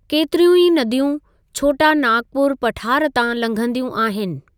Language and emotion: Sindhi, neutral